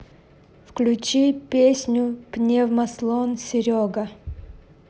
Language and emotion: Russian, neutral